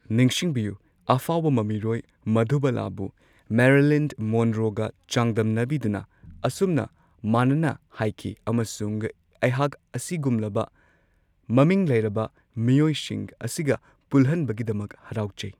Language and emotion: Manipuri, neutral